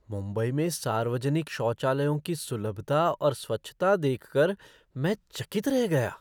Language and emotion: Hindi, surprised